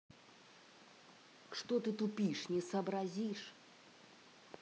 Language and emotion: Russian, angry